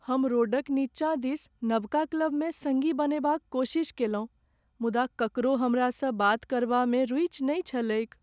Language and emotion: Maithili, sad